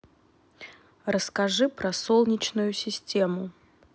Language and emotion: Russian, neutral